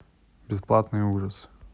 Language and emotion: Russian, neutral